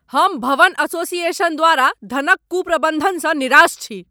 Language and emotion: Maithili, angry